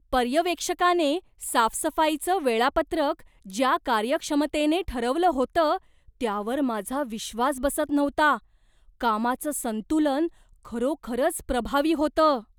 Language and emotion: Marathi, surprised